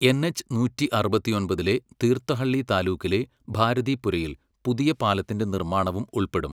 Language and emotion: Malayalam, neutral